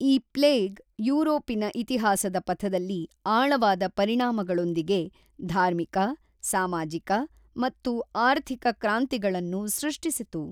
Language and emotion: Kannada, neutral